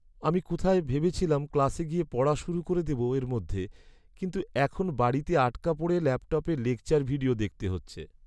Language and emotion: Bengali, sad